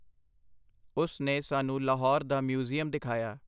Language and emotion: Punjabi, neutral